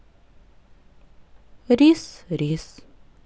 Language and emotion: Russian, neutral